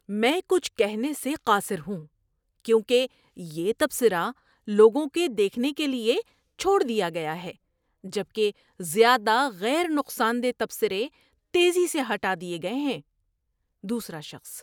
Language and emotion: Urdu, surprised